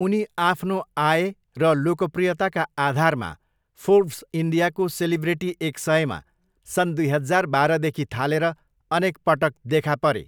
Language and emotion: Nepali, neutral